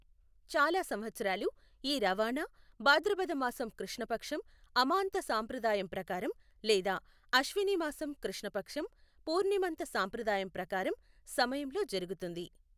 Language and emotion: Telugu, neutral